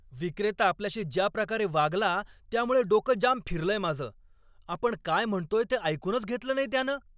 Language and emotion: Marathi, angry